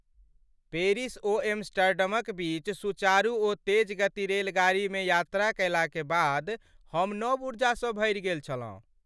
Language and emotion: Maithili, happy